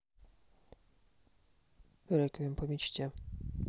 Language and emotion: Russian, neutral